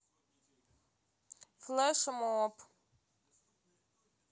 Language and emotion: Russian, neutral